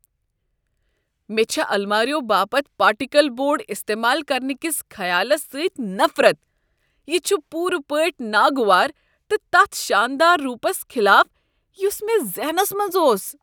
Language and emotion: Kashmiri, disgusted